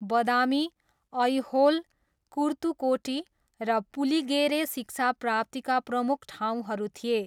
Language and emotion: Nepali, neutral